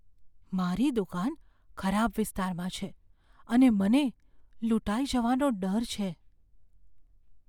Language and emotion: Gujarati, fearful